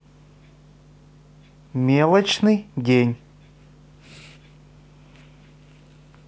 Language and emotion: Russian, neutral